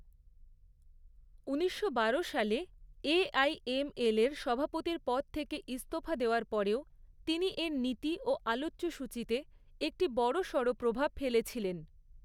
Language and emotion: Bengali, neutral